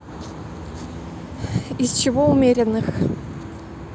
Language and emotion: Russian, neutral